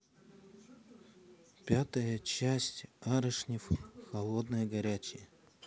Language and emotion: Russian, neutral